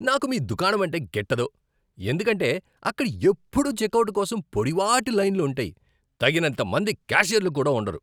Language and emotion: Telugu, angry